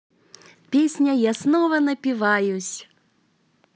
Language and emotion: Russian, positive